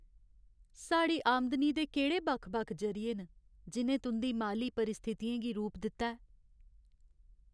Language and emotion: Dogri, sad